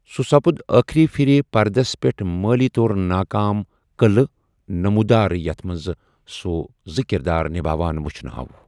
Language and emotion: Kashmiri, neutral